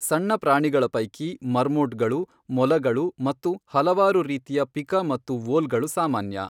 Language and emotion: Kannada, neutral